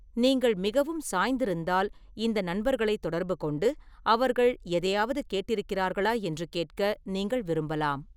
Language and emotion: Tamil, neutral